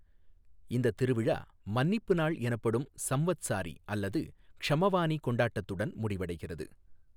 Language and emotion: Tamil, neutral